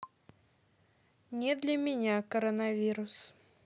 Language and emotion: Russian, neutral